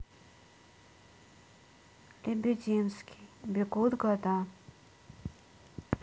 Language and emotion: Russian, sad